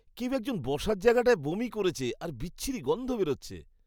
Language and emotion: Bengali, disgusted